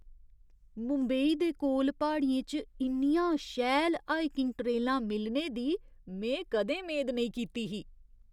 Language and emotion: Dogri, surprised